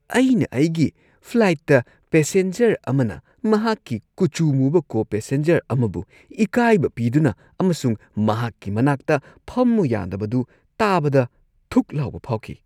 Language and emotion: Manipuri, disgusted